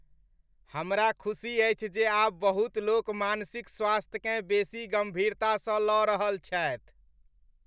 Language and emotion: Maithili, happy